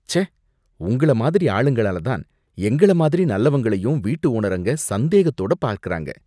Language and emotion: Tamil, disgusted